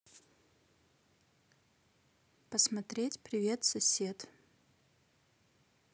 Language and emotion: Russian, neutral